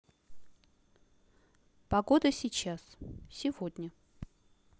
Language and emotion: Russian, neutral